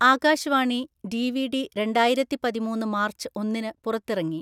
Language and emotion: Malayalam, neutral